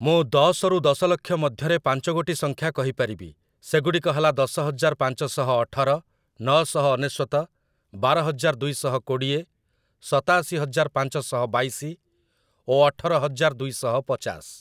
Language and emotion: Odia, neutral